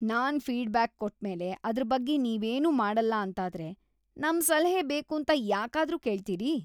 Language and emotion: Kannada, disgusted